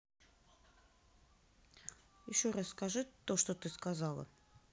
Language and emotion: Russian, neutral